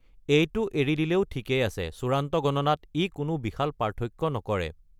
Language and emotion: Assamese, neutral